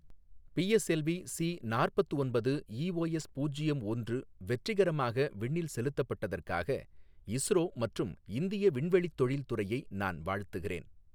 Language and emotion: Tamil, neutral